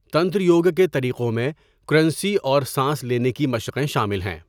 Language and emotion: Urdu, neutral